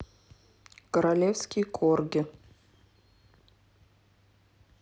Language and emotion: Russian, neutral